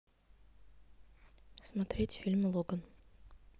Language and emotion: Russian, neutral